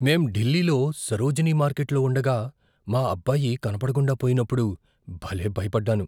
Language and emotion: Telugu, fearful